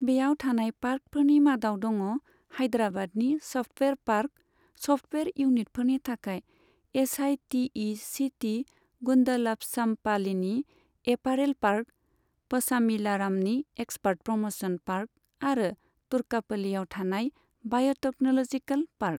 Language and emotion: Bodo, neutral